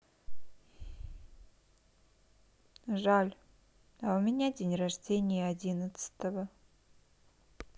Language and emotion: Russian, sad